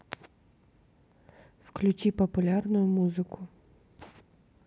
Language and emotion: Russian, neutral